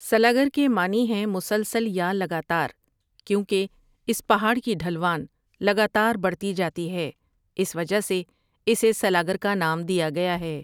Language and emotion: Urdu, neutral